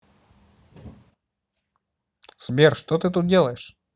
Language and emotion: Russian, neutral